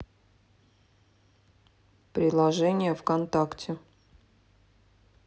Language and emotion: Russian, neutral